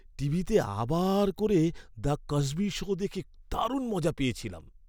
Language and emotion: Bengali, happy